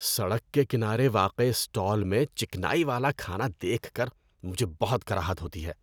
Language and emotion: Urdu, disgusted